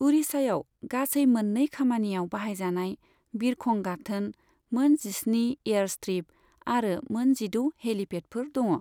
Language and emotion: Bodo, neutral